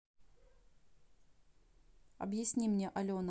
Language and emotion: Russian, neutral